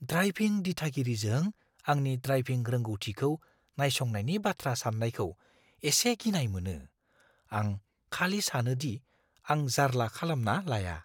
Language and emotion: Bodo, fearful